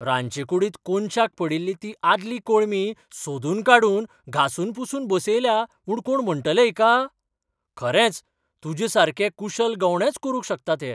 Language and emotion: Goan Konkani, surprised